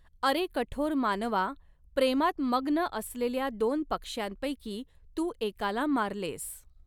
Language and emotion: Marathi, neutral